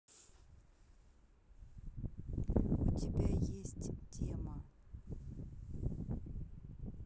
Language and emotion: Russian, neutral